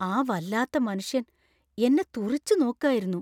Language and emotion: Malayalam, fearful